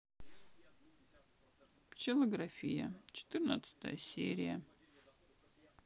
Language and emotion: Russian, sad